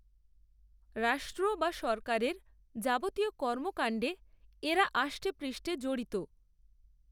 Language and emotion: Bengali, neutral